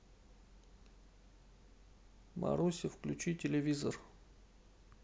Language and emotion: Russian, neutral